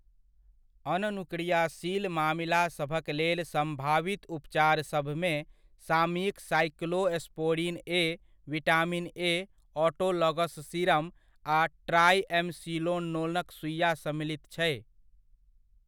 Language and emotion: Maithili, neutral